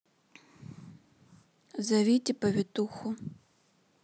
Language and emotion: Russian, neutral